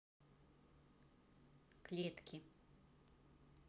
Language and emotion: Russian, neutral